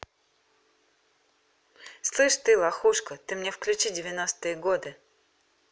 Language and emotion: Russian, angry